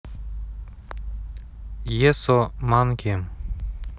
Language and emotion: Russian, neutral